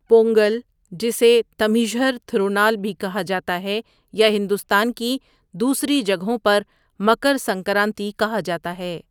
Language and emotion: Urdu, neutral